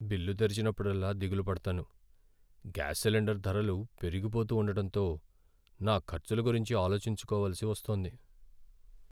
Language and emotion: Telugu, sad